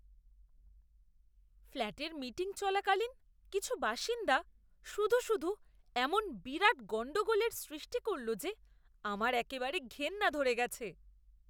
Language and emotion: Bengali, disgusted